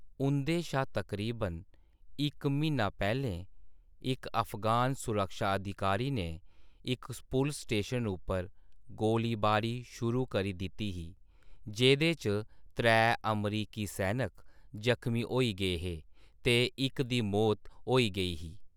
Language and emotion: Dogri, neutral